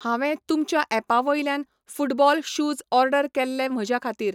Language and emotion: Goan Konkani, neutral